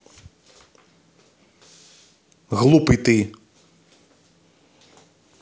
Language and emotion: Russian, angry